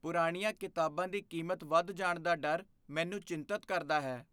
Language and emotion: Punjabi, fearful